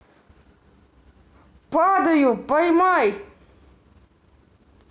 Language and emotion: Russian, neutral